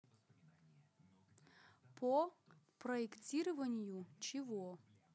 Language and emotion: Russian, neutral